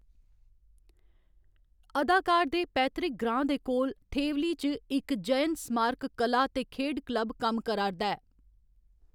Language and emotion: Dogri, neutral